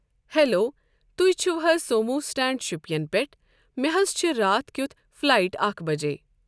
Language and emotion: Kashmiri, neutral